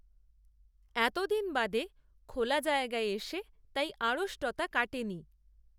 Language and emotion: Bengali, neutral